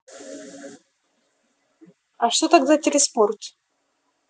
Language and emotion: Russian, neutral